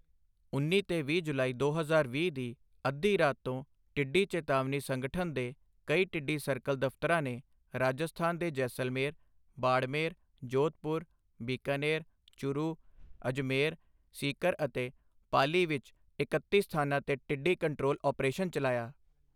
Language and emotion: Punjabi, neutral